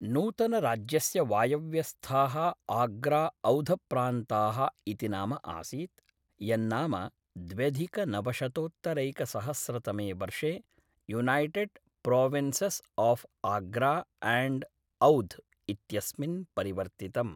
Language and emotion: Sanskrit, neutral